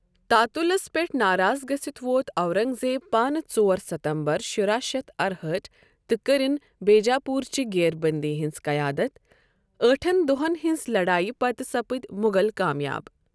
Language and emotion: Kashmiri, neutral